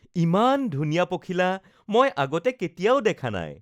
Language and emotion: Assamese, happy